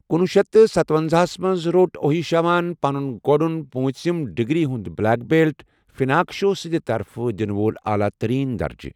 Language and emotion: Kashmiri, neutral